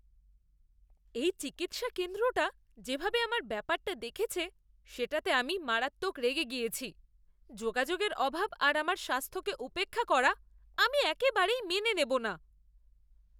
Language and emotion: Bengali, disgusted